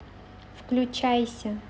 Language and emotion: Russian, neutral